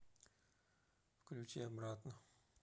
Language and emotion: Russian, neutral